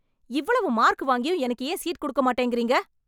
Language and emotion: Tamil, angry